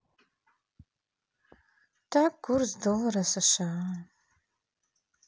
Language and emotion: Russian, sad